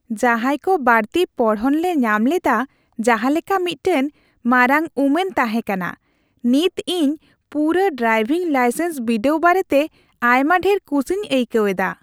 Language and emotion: Santali, happy